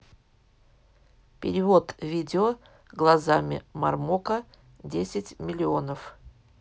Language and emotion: Russian, neutral